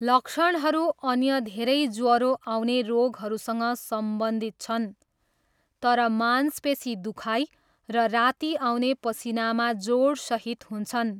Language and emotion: Nepali, neutral